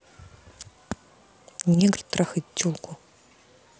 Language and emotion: Russian, angry